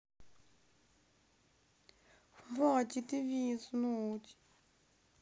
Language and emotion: Russian, sad